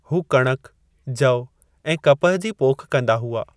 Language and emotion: Sindhi, neutral